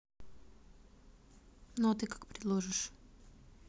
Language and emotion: Russian, neutral